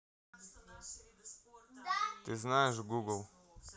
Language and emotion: Russian, neutral